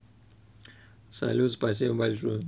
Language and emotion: Russian, neutral